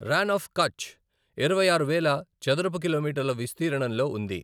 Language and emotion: Telugu, neutral